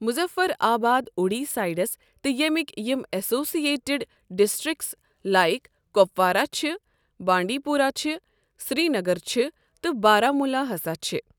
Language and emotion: Kashmiri, neutral